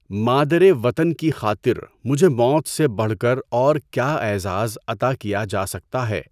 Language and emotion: Urdu, neutral